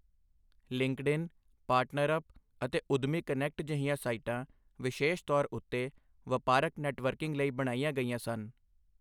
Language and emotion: Punjabi, neutral